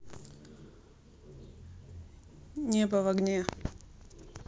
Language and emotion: Russian, neutral